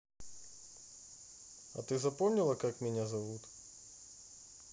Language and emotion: Russian, neutral